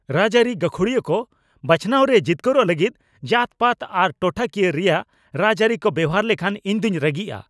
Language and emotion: Santali, angry